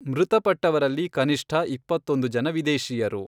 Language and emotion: Kannada, neutral